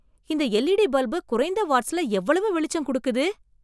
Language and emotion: Tamil, surprised